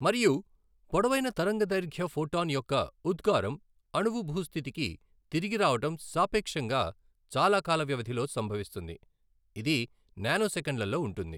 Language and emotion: Telugu, neutral